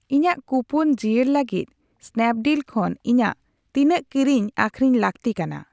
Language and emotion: Santali, neutral